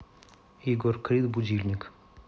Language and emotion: Russian, neutral